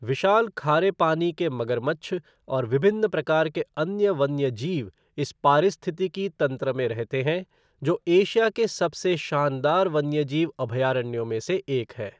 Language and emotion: Hindi, neutral